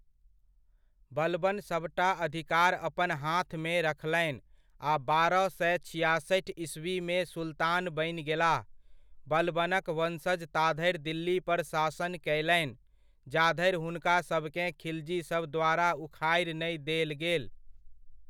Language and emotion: Maithili, neutral